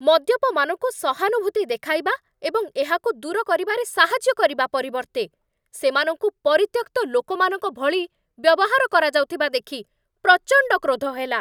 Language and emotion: Odia, angry